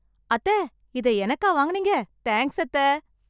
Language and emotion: Tamil, happy